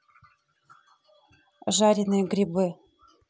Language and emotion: Russian, neutral